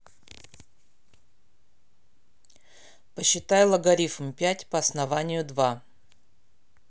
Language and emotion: Russian, angry